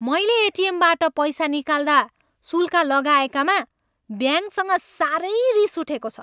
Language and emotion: Nepali, angry